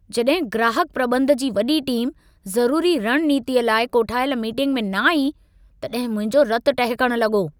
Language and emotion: Sindhi, angry